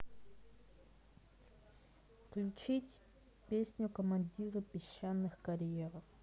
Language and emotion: Russian, neutral